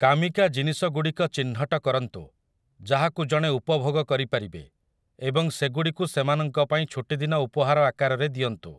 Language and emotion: Odia, neutral